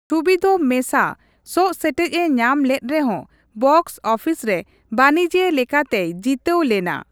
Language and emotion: Santali, neutral